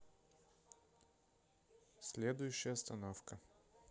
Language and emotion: Russian, neutral